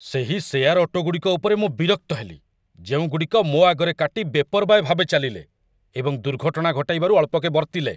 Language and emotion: Odia, angry